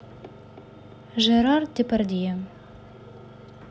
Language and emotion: Russian, neutral